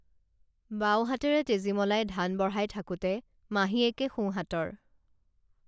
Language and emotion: Assamese, neutral